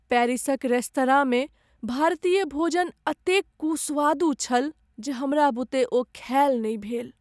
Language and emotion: Maithili, sad